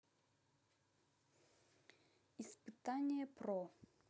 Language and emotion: Russian, neutral